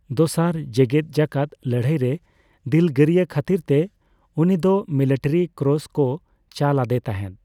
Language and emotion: Santali, neutral